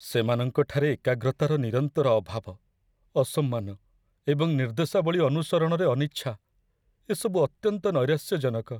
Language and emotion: Odia, sad